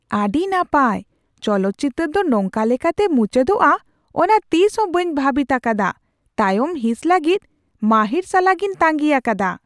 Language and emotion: Santali, surprised